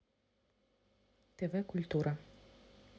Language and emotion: Russian, neutral